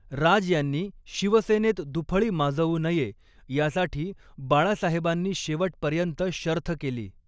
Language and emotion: Marathi, neutral